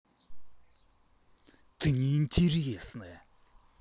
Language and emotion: Russian, angry